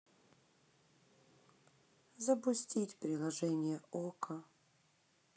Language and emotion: Russian, sad